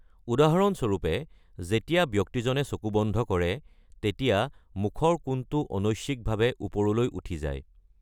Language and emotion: Assamese, neutral